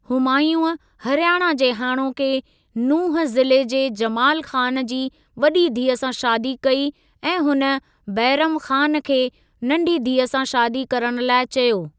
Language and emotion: Sindhi, neutral